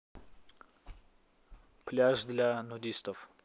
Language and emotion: Russian, neutral